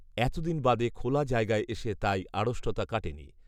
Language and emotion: Bengali, neutral